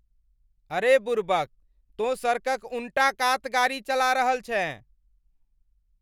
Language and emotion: Maithili, angry